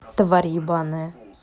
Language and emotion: Russian, angry